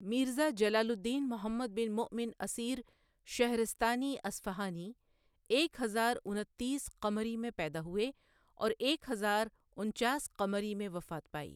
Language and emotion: Urdu, neutral